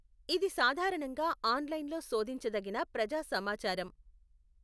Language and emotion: Telugu, neutral